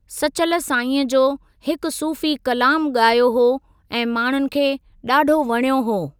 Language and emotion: Sindhi, neutral